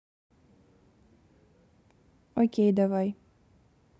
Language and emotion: Russian, neutral